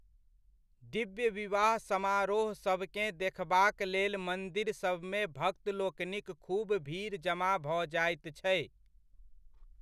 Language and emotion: Maithili, neutral